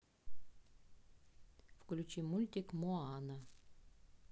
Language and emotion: Russian, neutral